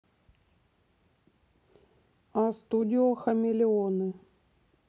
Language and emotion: Russian, neutral